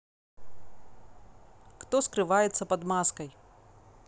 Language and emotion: Russian, neutral